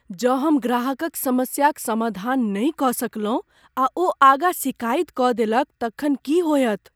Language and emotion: Maithili, fearful